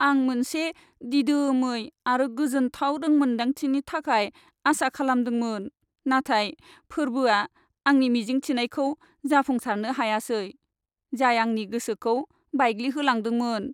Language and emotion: Bodo, sad